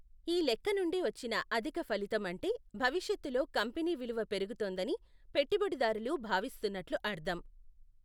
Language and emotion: Telugu, neutral